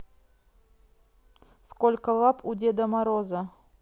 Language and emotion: Russian, neutral